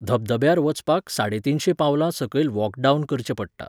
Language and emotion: Goan Konkani, neutral